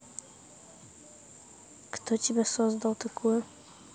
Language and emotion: Russian, neutral